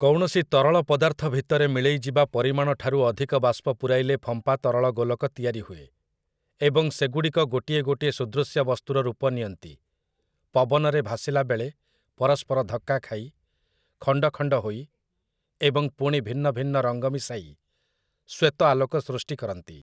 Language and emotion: Odia, neutral